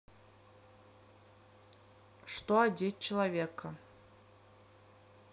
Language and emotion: Russian, neutral